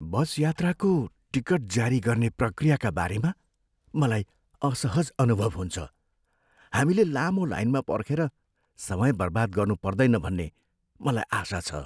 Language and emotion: Nepali, fearful